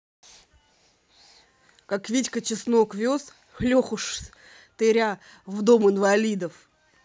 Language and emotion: Russian, angry